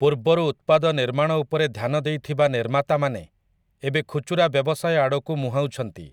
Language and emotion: Odia, neutral